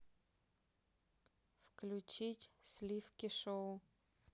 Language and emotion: Russian, neutral